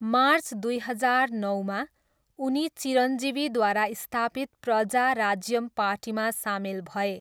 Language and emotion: Nepali, neutral